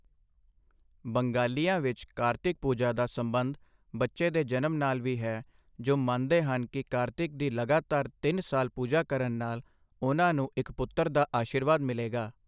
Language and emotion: Punjabi, neutral